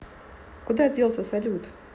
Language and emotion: Russian, neutral